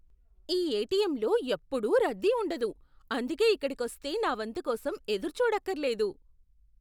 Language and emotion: Telugu, surprised